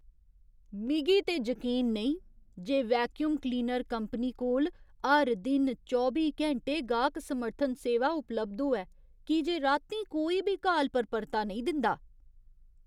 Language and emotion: Dogri, surprised